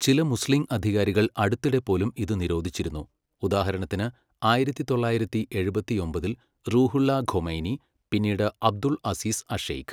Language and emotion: Malayalam, neutral